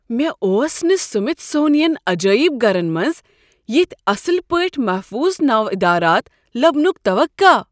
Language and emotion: Kashmiri, surprised